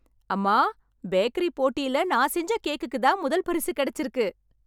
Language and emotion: Tamil, happy